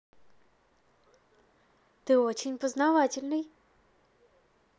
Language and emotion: Russian, positive